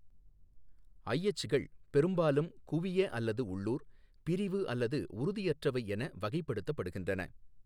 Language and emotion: Tamil, neutral